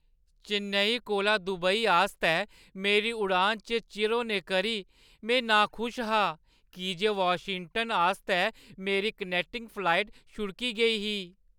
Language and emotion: Dogri, sad